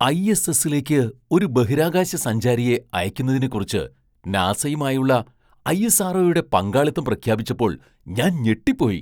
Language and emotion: Malayalam, surprised